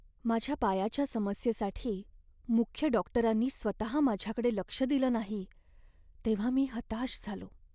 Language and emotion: Marathi, sad